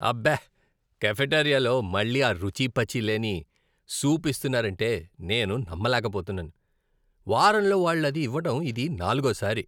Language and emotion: Telugu, disgusted